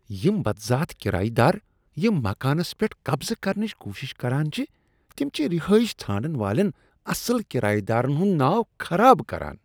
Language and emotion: Kashmiri, disgusted